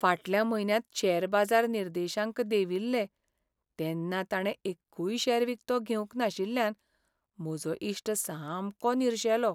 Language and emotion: Goan Konkani, sad